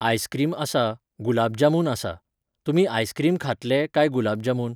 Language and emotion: Goan Konkani, neutral